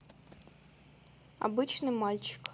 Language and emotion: Russian, neutral